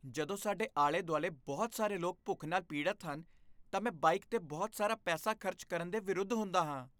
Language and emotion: Punjabi, disgusted